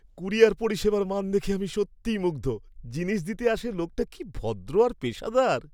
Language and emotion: Bengali, happy